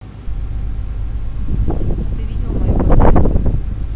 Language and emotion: Russian, neutral